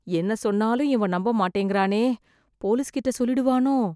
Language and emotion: Tamil, fearful